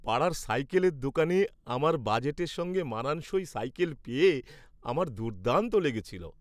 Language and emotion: Bengali, happy